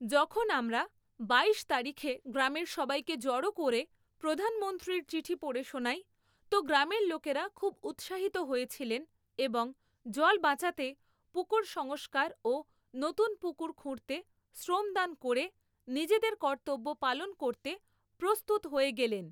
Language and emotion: Bengali, neutral